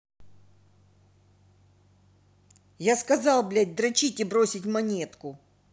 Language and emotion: Russian, angry